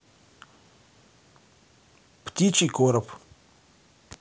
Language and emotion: Russian, neutral